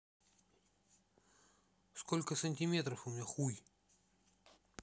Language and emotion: Russian, neutral